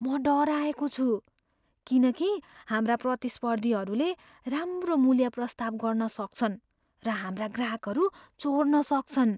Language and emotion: Nepali, fearful